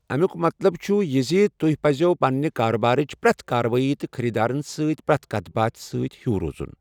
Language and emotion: Kashmiri, neutral